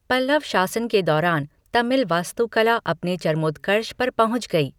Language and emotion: Hindi, neutral